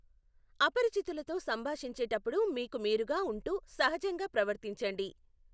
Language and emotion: Telugu, neutral